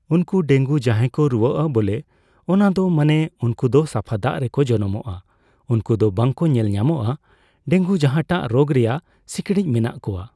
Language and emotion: Santali, neutral